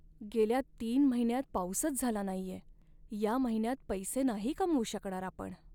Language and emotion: Marathi, sad